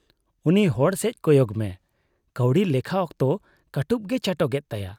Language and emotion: Santali, disgusted